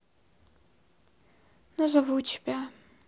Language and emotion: Russian, sad